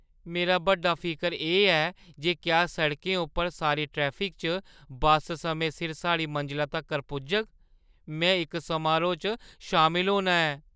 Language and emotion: Dogri, fearful